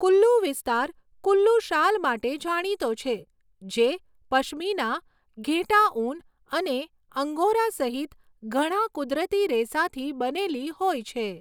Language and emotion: Gujarati, neutral